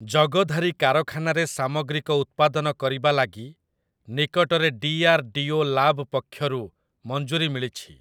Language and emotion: Odia, neutral